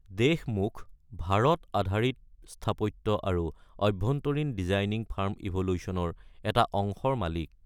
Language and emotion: Assamese, neutral